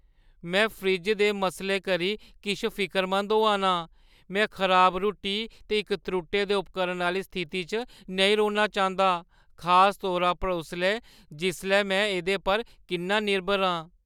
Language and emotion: Dogri, fearful